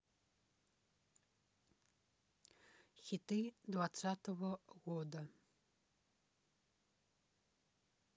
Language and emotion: Russian, neutral